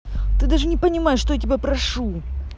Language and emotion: Russian, angry